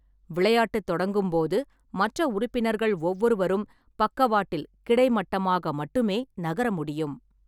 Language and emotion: Tamil, neutral